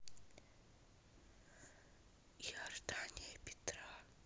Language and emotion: Russian, neutral